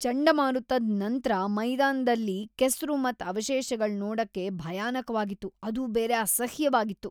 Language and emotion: Kannada, disgusted